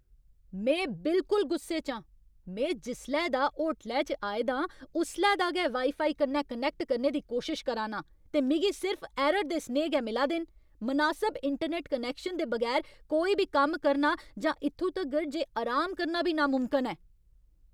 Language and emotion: Dogri, angry